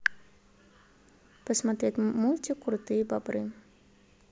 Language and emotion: Russian, neutral